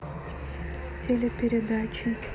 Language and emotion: Russian, neutral